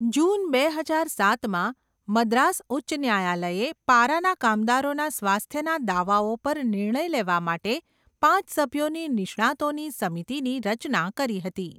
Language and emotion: Gujarati, neutral